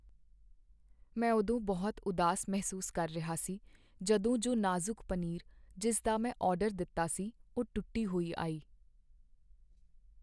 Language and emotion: Punjabi, sad